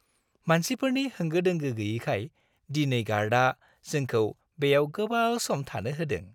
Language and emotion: Bodo, happy